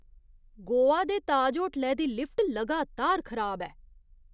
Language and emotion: Dogri, disgusted